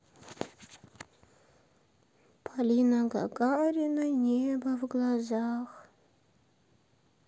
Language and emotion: Russian, sad